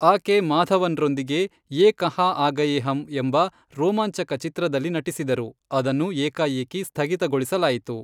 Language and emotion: Kannada, neutral